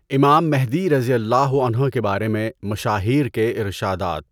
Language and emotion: Urdu, neutral